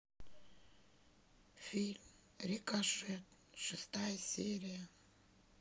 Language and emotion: Russian, sad